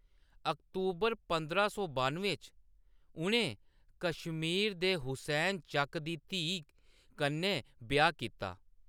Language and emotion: Dogri, neutral